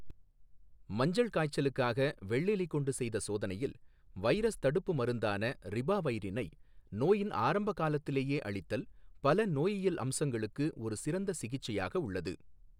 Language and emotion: Tamil, neutral